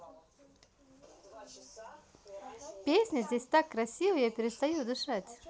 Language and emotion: Russian, positive